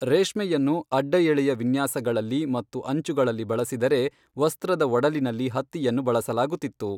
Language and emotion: Kannada, neutral